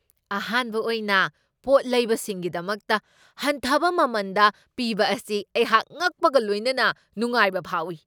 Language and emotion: Manipuri, surprised